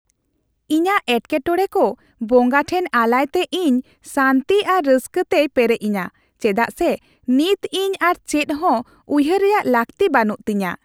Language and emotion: Santali, happy